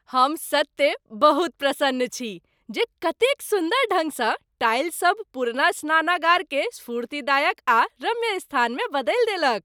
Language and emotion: Maithili, happy